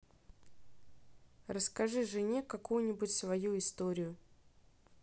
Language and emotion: Russian, neutral